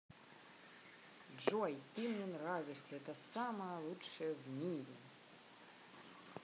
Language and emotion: Russian, positive